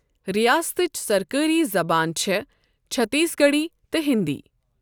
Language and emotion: Kashmiri, neutral